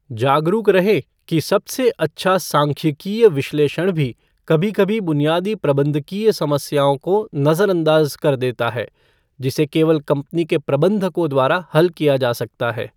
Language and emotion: Hindi, neutral